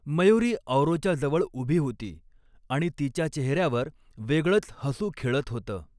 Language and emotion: Marathi, neutral